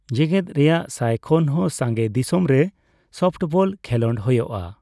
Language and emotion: Santali, neutral